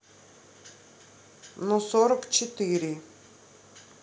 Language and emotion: Russian, neutral